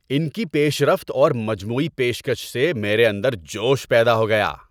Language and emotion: Urdu, happy